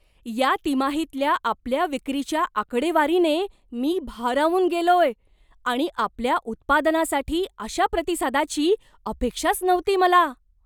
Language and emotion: Marathi, surprised